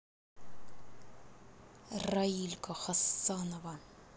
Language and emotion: Russian, neutral